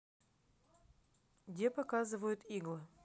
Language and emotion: Russian, neutral